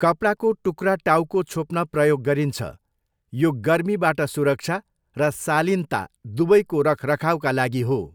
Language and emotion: Nepali, neutral